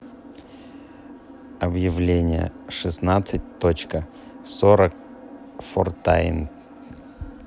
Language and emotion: Russian, neutral